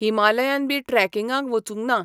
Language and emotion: Goan Konkani, neutral